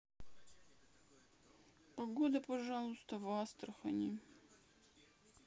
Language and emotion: Russian, sad